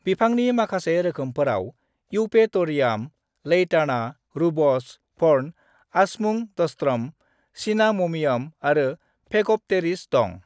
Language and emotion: Bodo, neutral